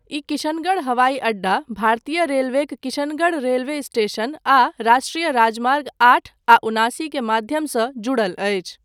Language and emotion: Maithili, neutral